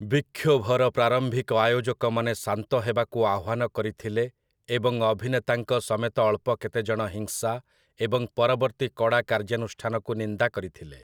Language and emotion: Odia, neutral